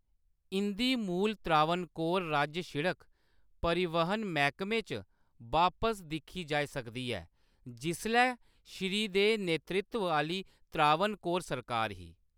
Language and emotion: Dogri, neutral